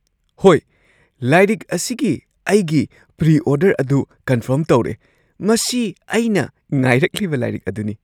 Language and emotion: Manipuri, surprised